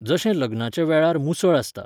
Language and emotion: Goan Konkani, neutral